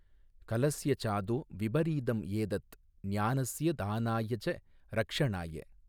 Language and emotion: Tamil, neutral